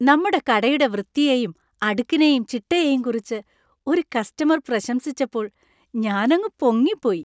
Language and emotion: Malayalam, happy